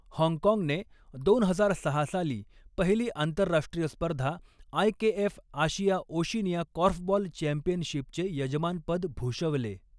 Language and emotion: Marathi, neutral